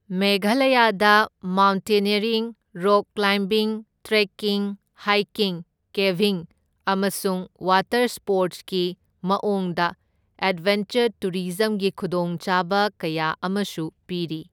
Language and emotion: Manipuri, neutral